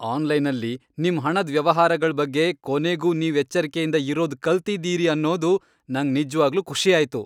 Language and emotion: Kannada, happy